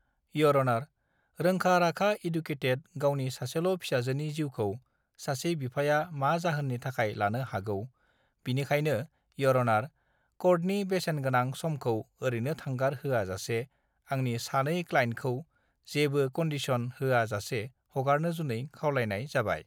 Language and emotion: Bodo, neutral